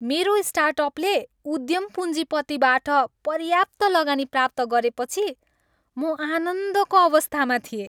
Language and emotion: Nepali, happy